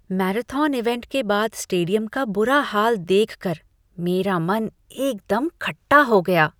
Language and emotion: Hindi, disgusted